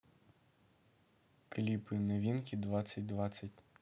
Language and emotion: Russian, neutral